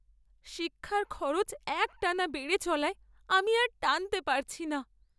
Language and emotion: Bengali, sad